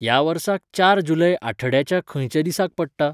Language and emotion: Goan Konkani, neutral